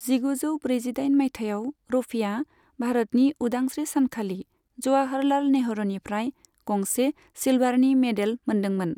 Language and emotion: Bodo, neutral